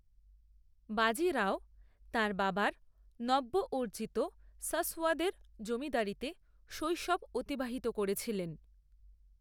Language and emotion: Bengali, neutral